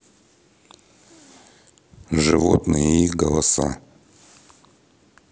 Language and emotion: Russian, neutral